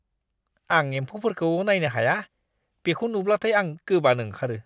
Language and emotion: Bodo, disgusted